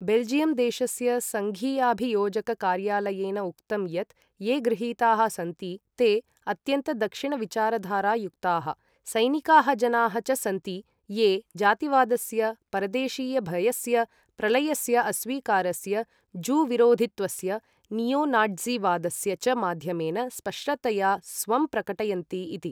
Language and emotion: Sanskrit, neutral